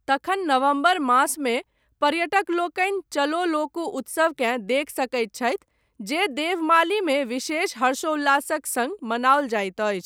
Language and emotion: Maithili, neutral